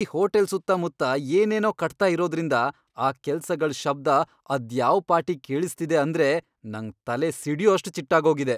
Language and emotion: Kannada, angry